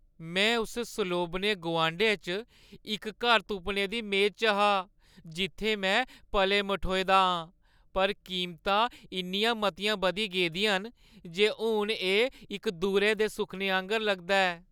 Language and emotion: Dogri, sad